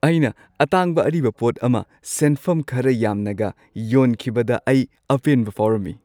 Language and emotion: Manipuri, happy